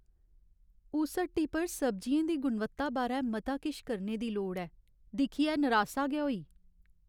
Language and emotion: Dogri, sad